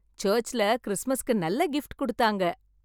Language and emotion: Tamil, happy